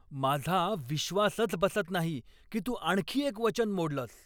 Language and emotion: Marathi, angry